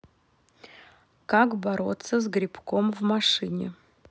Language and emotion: Russian, neutral